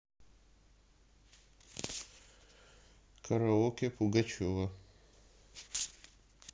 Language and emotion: Russian, neutral